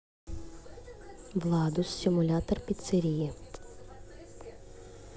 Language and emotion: Russian, neutral